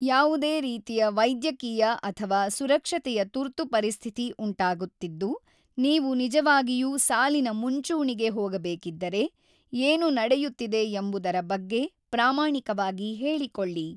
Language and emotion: Kannada, neutral